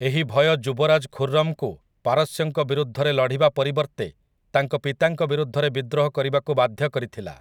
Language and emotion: Odia, neutral